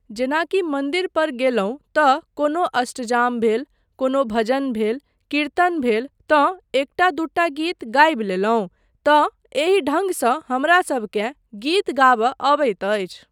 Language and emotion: Maithili, neutral